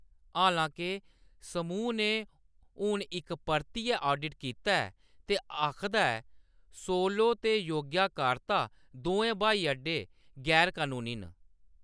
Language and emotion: Dogri, neutral